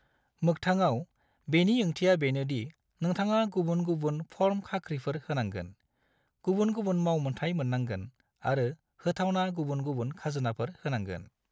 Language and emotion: Bodo, neutral